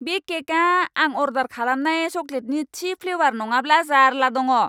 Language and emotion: Bodo, angry